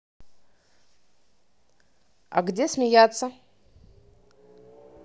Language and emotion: Russian, neutral